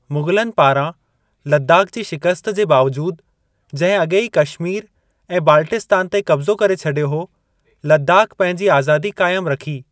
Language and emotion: Sindhi, neutral